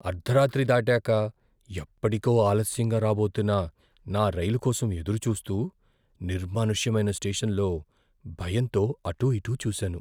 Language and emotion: Telugu, fearful